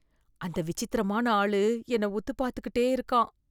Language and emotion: Tamil, fearful